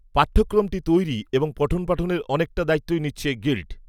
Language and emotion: Bengali, neutral